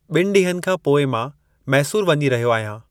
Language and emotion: Sindhi, neutral